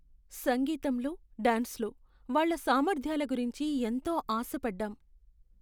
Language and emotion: Telugu, sad